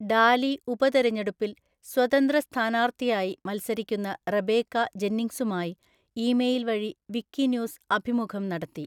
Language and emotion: Malayalam, neutral